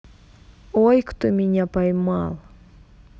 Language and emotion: Russian, neutral